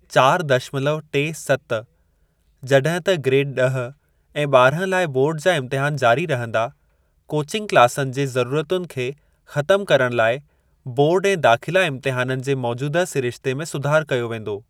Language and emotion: Sindhi, neutral